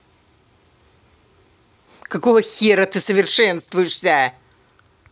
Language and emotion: Russian, angry